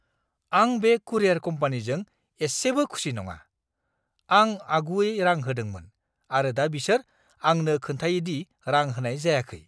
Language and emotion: Bodo, angry